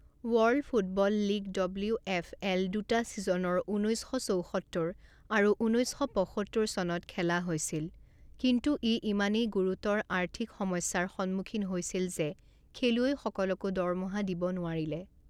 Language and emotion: Assamese, neutral